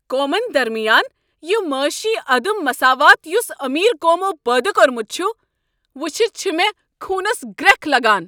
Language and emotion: Kashmiri, angry